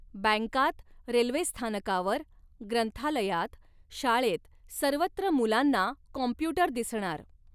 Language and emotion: Marathi, neutral